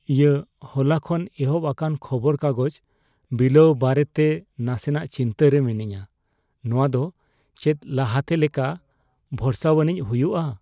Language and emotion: Santali, fearful